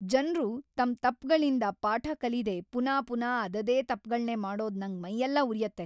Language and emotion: Kannada, angry